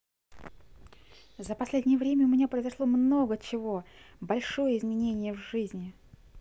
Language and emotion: Russian, positive